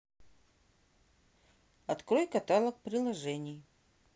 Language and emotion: Russian, neutral